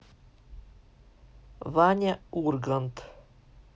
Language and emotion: Russian, neutral